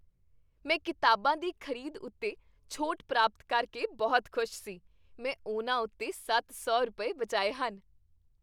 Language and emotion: Punjabi, happy